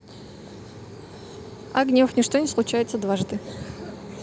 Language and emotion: Russian, neutral